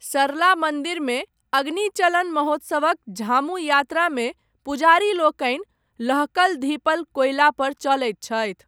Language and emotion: Maithili, neutral